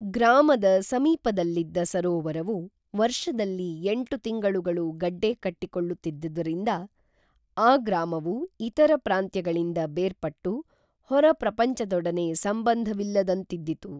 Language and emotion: Kannada, neutral